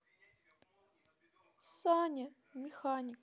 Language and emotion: Russian, sad